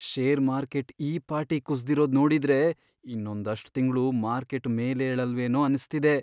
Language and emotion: Kannada, fearful